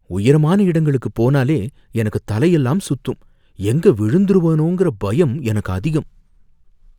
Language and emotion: Tamil, fearful